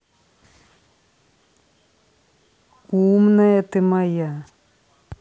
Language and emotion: Russian, positive